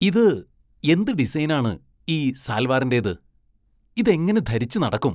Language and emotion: Malayalam, disgusted